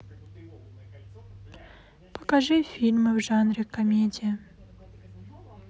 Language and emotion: Russian, sad